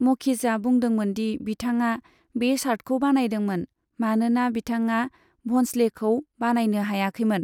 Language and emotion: Bodo, neutral